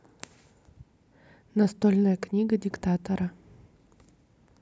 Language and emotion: Russian, neutral